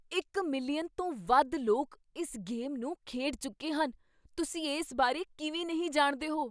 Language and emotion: Punjabi, surprised